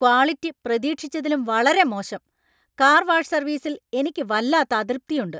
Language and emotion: Malayalam, angry